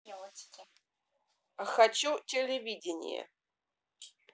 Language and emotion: Russian, neutral